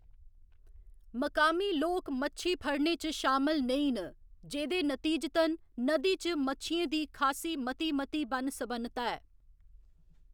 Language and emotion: Dogri, neutral